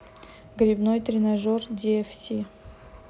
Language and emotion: Russian, neutral